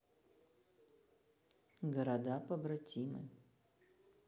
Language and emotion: Russian, neutral